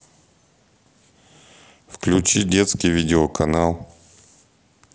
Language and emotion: Russian, neutral